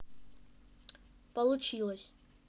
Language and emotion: Russian, neutral